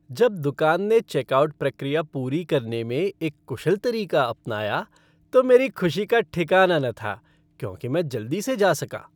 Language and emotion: Hindi, happy